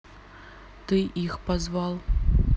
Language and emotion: Russian, neutral